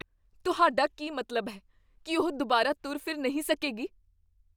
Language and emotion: Punjabi, fearful